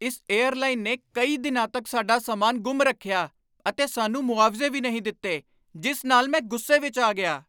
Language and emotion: Punjabi, angry